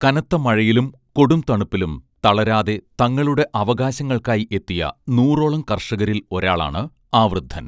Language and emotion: Malayalam, neutral